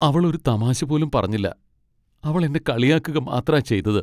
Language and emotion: Malayalam, sad